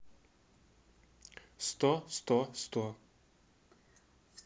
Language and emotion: Russian, neutral